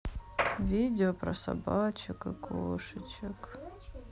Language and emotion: Russian, sad